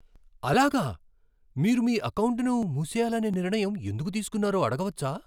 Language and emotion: Telugu, surprised